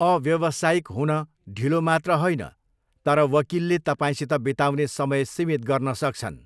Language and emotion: Nepali, neutral